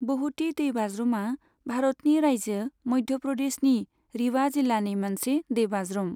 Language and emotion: Bodo, neutral